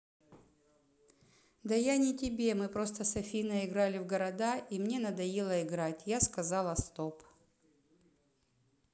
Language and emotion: Russian, neutral